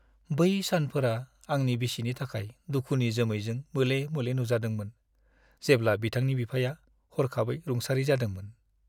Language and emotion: Bodo, sad